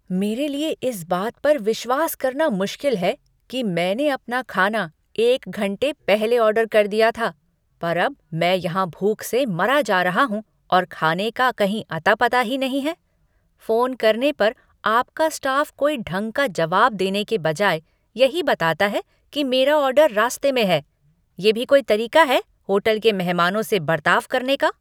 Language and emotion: Hindi, angry